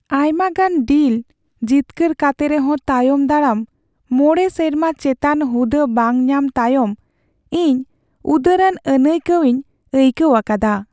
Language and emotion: Santali, sad